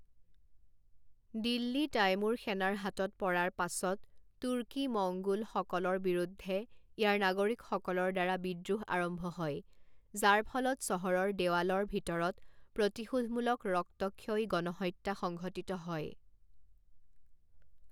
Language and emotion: Assamese, neutral